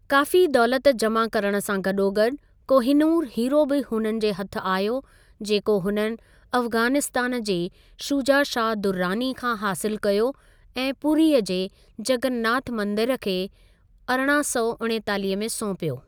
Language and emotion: Sindhi, neutral